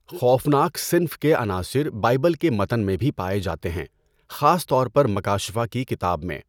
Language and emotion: Urdu, neutral